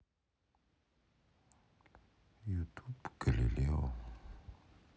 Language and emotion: Russian, sad